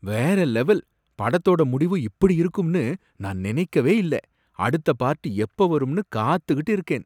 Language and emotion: Tamil, surprised